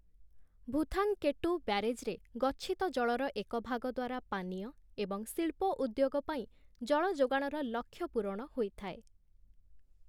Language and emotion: Odia, neutral